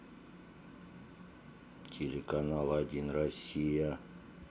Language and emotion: Russian, neutral